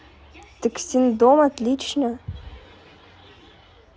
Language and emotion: Russian, positive